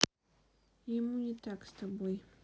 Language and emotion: Russian, neutral